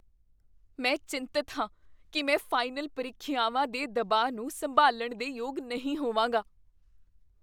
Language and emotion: Punjabi, fearful